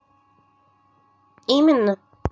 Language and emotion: Russian, neutral